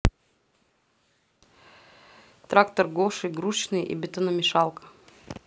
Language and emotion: Russian, neutral